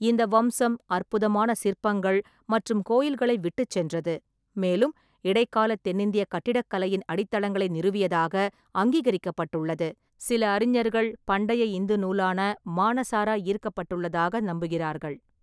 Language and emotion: Tamil, neutral